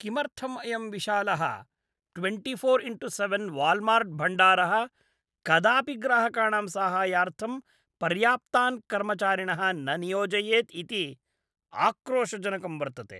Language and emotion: Sanskrit, disgusted